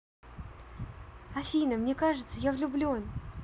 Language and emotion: Russian, positive